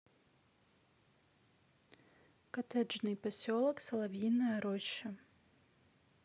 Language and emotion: Russian, neutral